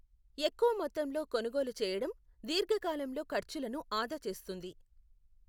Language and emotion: Telugu, neutral